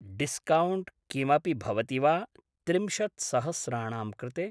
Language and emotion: Sanskrit, neutral